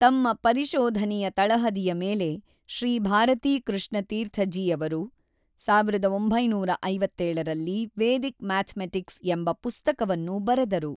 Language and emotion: Kannada, neutral